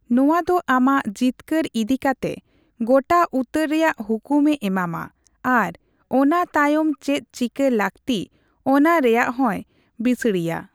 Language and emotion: Santali, neutral